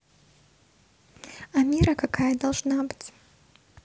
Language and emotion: Russian, neutral